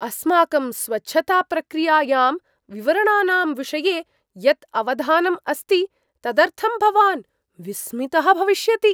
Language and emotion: Sanskrit, surprised